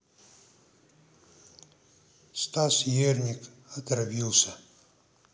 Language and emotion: Russian, neutral